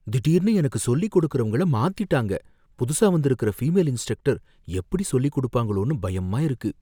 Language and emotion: Tamil, fearful